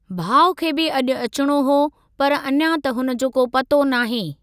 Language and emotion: Sindhi, neutral